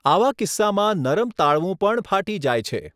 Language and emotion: Gujarati, neutral